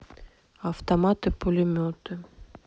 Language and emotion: Russian, neutral